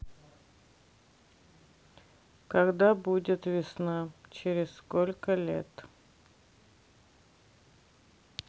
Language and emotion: Russian, sad